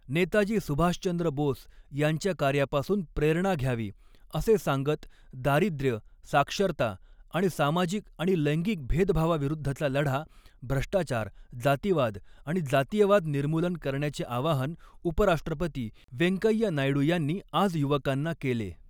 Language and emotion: Marathi, neutral